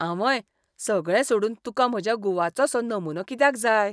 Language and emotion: Goan Konkani, disgusted